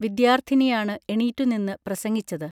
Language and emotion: Malayalam, neutral